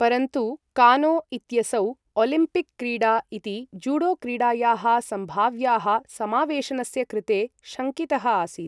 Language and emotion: Sanskrit, neutral